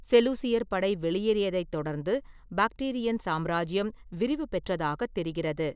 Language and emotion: Tamil, neutral